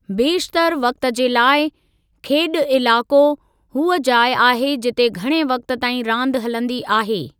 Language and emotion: Sindhi, neutral